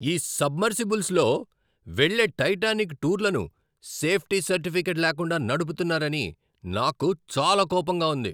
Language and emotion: Telugu, angry